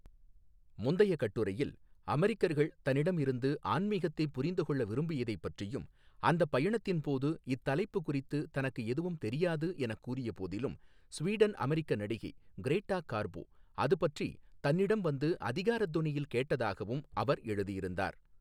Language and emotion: Tamil, neutral